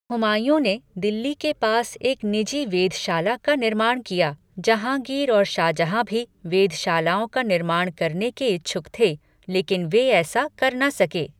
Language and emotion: Hindi, neutral